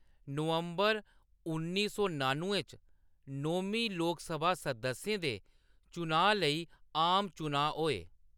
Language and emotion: Dogri, neutral